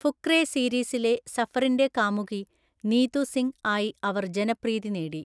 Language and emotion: Malayalam, neutral